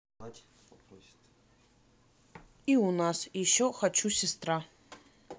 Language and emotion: Russian, neutral